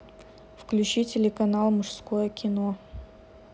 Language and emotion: Russian, neutral